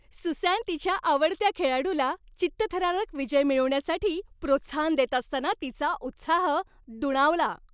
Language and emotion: Marathi, happy